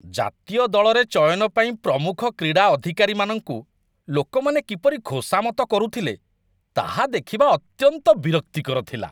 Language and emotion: Odia, disgusted